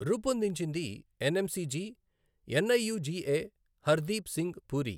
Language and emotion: Telugu, neutral